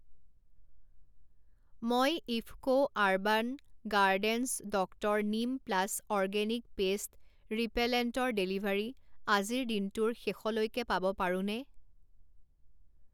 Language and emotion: Assamese, neutral